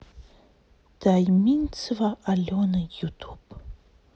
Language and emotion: Russian, sad